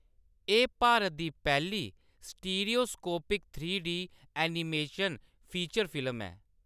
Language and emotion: Dogri, neutral